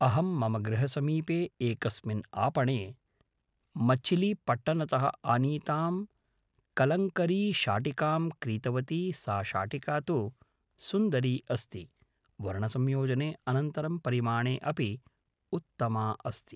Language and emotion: Sanskrit, neutral